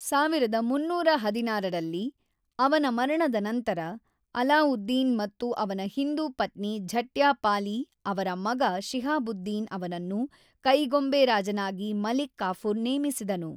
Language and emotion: Kannada, neutral